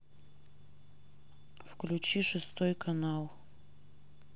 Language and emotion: Russian, neutral